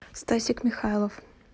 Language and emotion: Russian, neutral